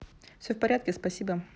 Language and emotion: Russian, neutral